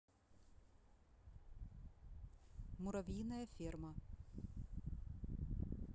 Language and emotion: Russian, neutral